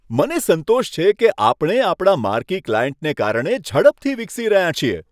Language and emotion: Gujarati, happy